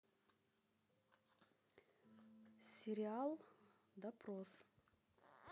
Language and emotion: Russian, neutral